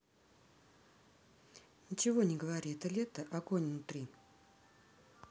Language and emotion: Russian, neutral